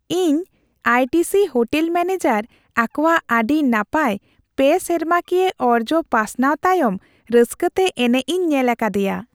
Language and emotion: Santali, happy